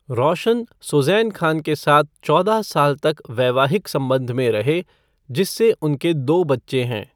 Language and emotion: Hindi, neutral